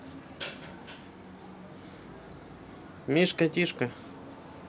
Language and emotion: Russian, neutral